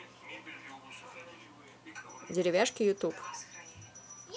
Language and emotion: Russian, neutral